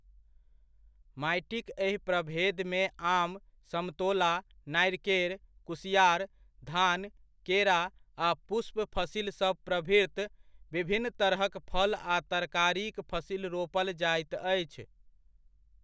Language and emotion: Maithili, neutral